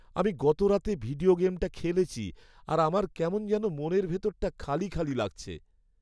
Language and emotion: Bengali, sad